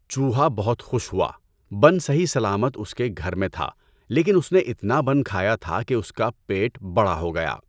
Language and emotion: Urdu, neutral